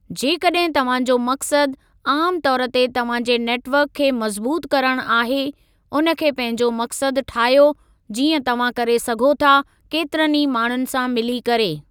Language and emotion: Sindhi, neutral